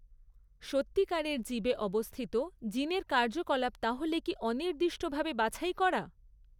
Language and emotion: Bengali, neutral